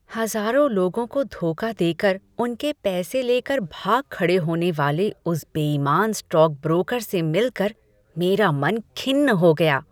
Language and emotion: Hindi, disgusted